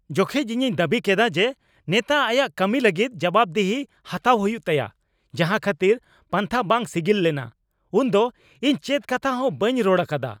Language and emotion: Santali, angry